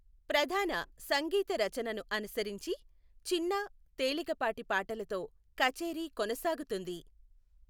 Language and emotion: Telugu, neutral